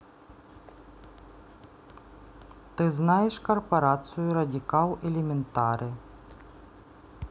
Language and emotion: Russian, neutral